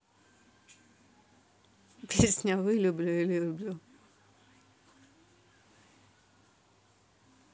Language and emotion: Russian, neutral